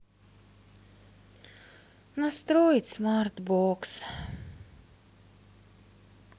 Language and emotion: Russian, sad